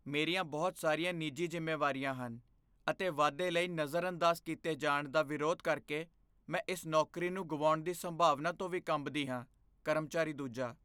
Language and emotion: Punjabi, fearful